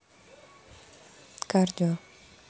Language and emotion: Russian, neutral